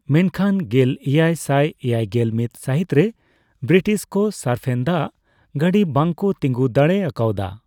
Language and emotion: Santali, neutral